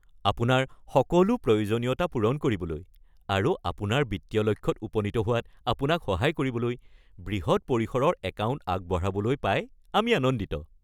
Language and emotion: Assamese, happy